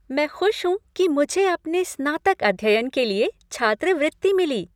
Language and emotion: Hindi, happy